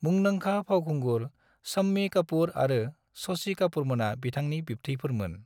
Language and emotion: Bodo, neutral